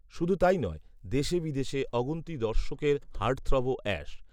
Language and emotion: Bengali, neutral